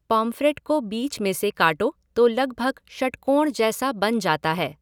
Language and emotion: Hindi, neutral